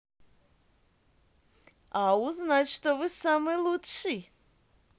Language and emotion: Russian, positive